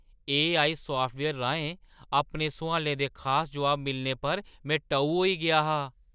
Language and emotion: Dogri, surprised